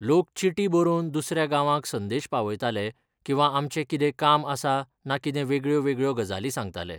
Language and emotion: Goan Konkani, neutral